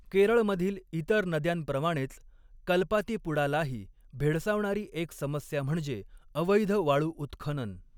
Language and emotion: Marathi, neutral